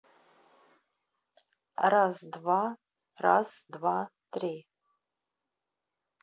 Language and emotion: Russian, neutral